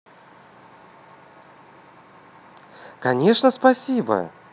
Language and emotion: Russian, positive